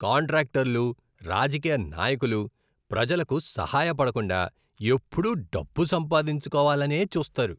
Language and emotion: Telugu, disgusted